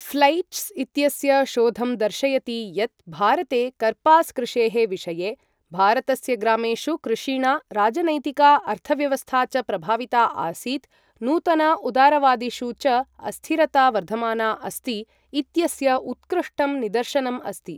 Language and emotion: Sanskrit, neutral